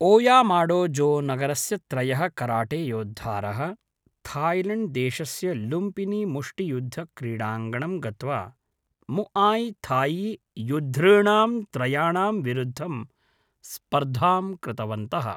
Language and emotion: Sanskrit, neutral